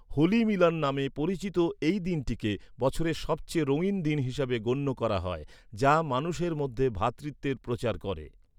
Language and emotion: Bengali, neutral